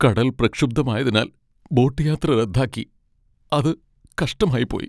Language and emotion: Malayalam, sad